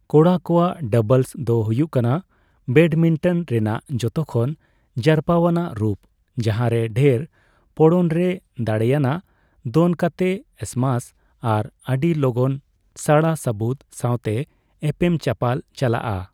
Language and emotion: Santali, neutral